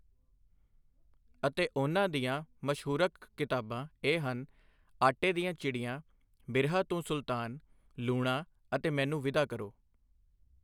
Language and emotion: Punjabi, neutral